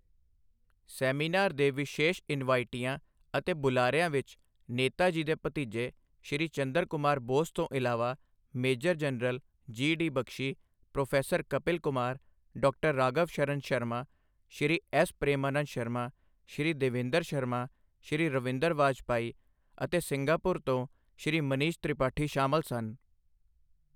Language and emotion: Punjabi, neutral